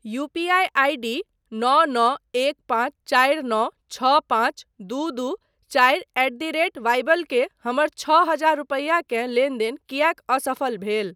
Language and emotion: Maithili, neutral